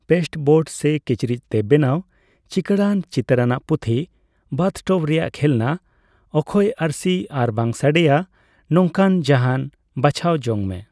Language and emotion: Santali, neutral